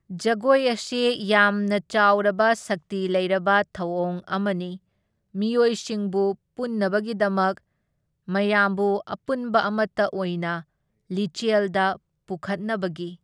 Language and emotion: Manipuri, neutral